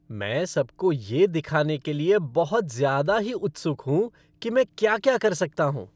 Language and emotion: Hindi, happy